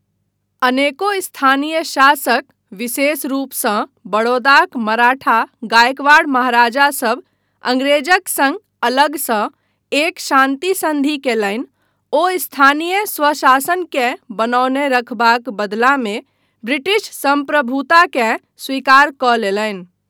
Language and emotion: Maithili, neutral